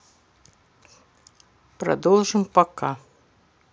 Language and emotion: Russian, neutral